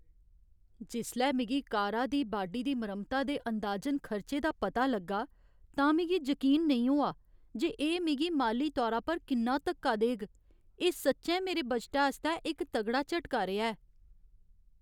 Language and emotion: Dogri, sad